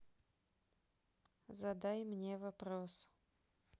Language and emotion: Russian, neutral